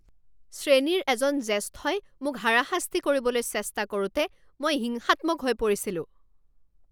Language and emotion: Assamese, angry